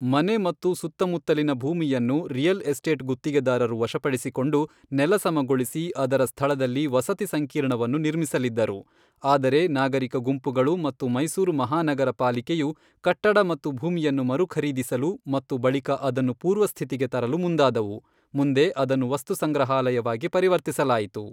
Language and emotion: Kannada, neutral